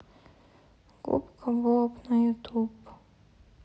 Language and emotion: Russian, sad